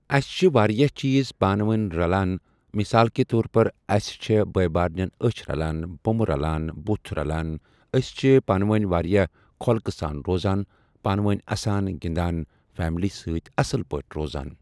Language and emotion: Kashmiri, neutral